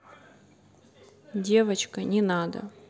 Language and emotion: Russian, neutral